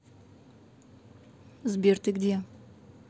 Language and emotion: Russian, neutral